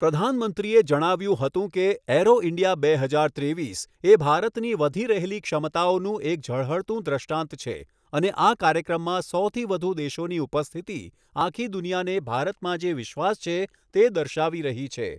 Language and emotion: Gujarati, neutral